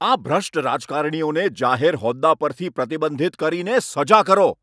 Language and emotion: Gujarati, angry